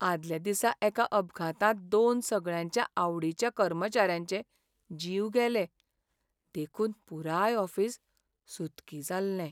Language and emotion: Goan Konkani, sad